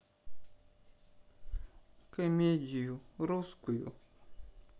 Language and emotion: Russian, sad